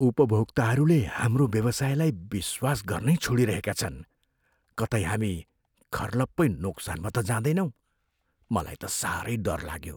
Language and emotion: Nepali, fearful